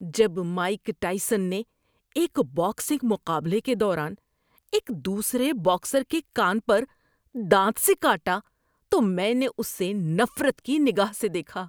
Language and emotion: Urdu, disgusted